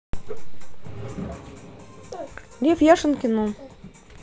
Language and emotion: Russian, neutral